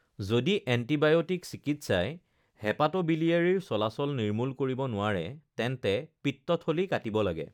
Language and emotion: Assamese, neutral